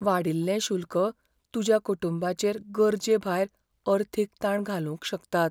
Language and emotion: Goan Konkani, fearful